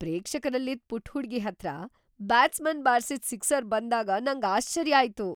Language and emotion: Kannada, surprised